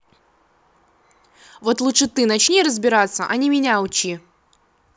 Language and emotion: Russian, angry